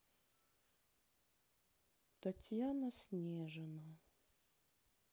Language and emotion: Russian, sad